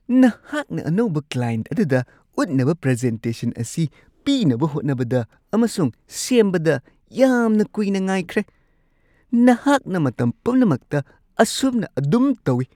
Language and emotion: Manipuri, disgusted